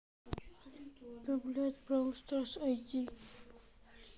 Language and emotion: Russian, neutral